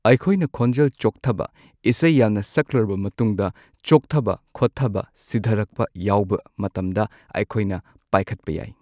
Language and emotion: Manipuri, neutral